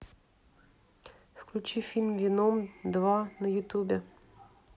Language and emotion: Russian, neutral